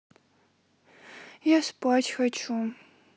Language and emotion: Russian, sad